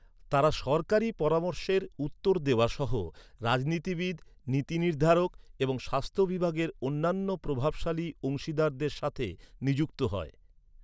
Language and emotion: Bengali, neutral